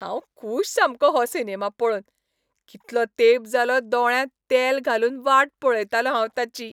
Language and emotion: Goan Konkani, happy